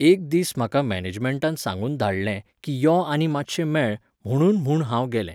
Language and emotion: Goan Konkani, neutral